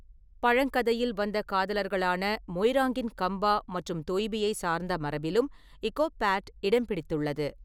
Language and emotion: Tamil, neutral